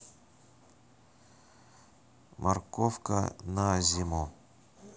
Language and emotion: Russian, neutral